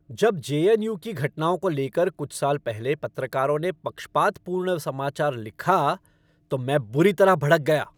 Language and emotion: Hindi, angry